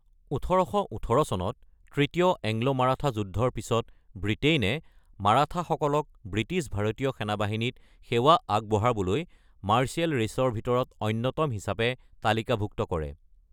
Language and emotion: Assamese, neutral